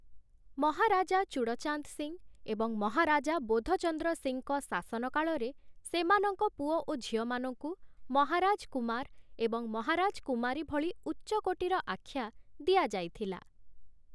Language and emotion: Odia, neutral